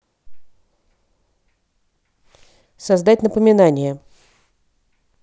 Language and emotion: Russian, neutral